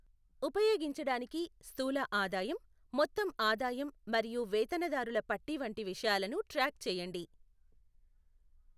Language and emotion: Telugu, neutral